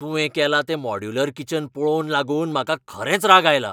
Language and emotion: Goan Konkani, angry